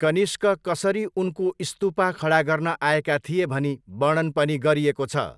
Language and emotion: Nepali, neutral